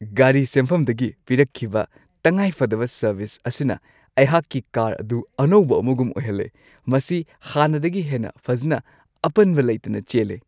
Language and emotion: Manipuri, happy